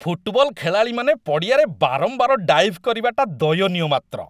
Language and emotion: Odia, disgusted